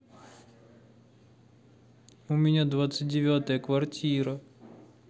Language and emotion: Russian, sad